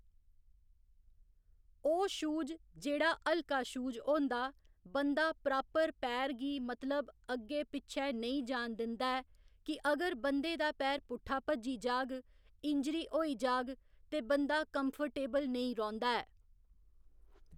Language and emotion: Dogri, neutral